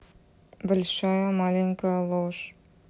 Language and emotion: Russian, neutral